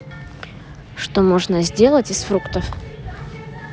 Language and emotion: Russian, neutral